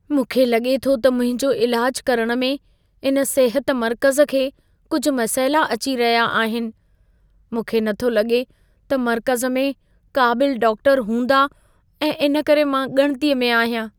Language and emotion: Sindhi, fearful